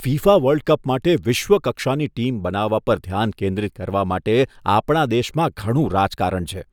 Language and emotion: Gujarati, disgusted